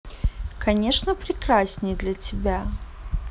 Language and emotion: Russian, positive